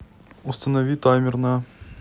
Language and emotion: Russian, neutral